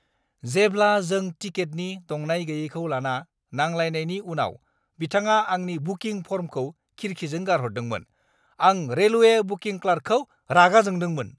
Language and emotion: Bodo, angry